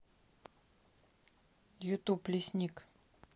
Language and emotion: Russian, neutral